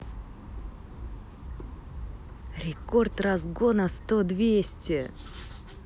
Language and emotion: Russian, positive